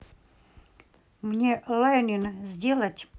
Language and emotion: Russian, neutral